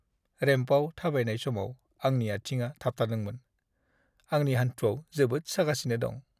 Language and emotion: Bodo, sad